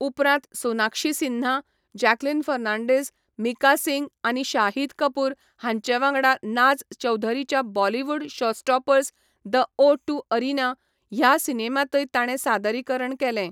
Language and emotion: Goan Konkani, neutral